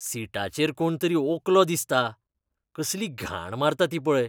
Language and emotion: Goan Konkani, disgusted